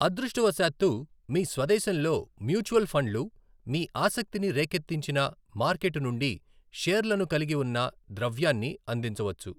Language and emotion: Telugu, neutral